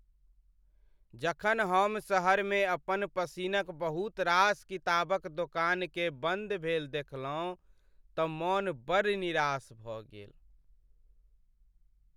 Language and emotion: Maithili, sad